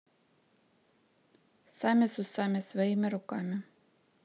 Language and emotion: Russian, neutral